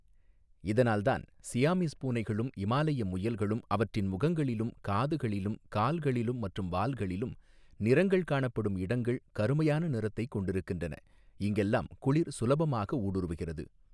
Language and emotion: Tamil, neutral